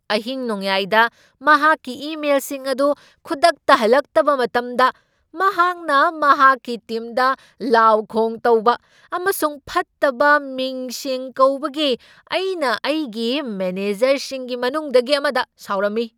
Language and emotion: Manipuri, angry